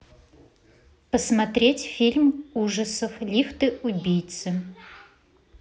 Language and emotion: Russian, neutral